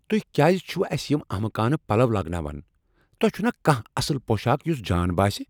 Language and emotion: Kashmiri, angry